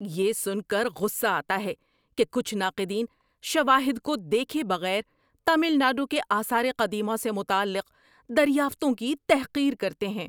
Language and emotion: Urdu, angry